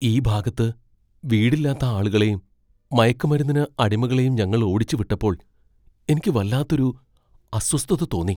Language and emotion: Malayalam, fearful